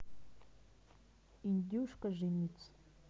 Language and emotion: Russian, neutral